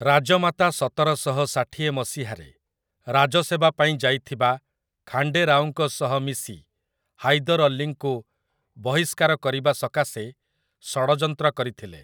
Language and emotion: Odia, neutral